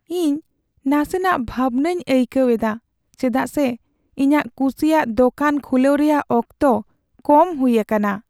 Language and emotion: Santali, sad